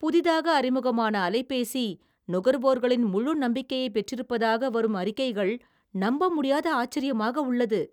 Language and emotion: Tamil, surprised